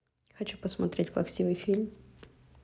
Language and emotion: Russian, neutral